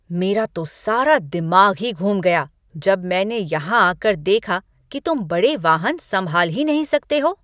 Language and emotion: Hindi, angry